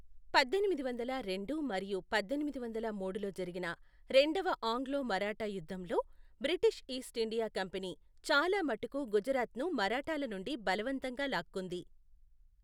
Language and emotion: Telugu, neutral